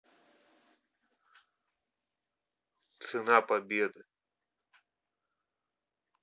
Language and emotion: Russian, neutral